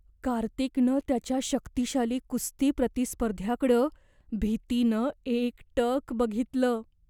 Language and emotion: Marathi, fearful